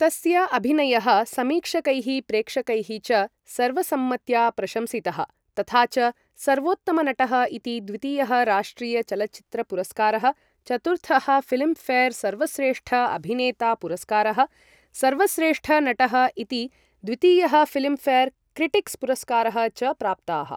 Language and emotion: Sanskrit, neutral